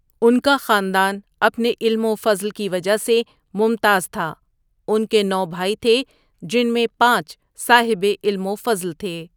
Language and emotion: Urdu, neutral